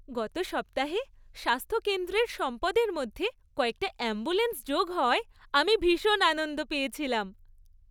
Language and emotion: Bengali, happy